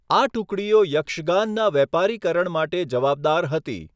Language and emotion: Gujarati, neutral